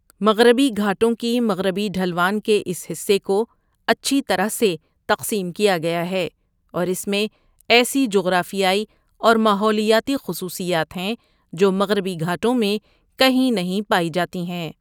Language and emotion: Urdu, neutral